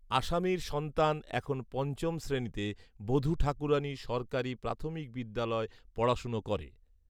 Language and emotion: Bengali, neutral